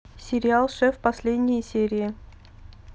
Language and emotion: Russian, neutral